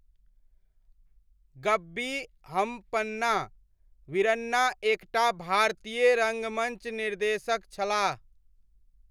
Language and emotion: Maithili, neutral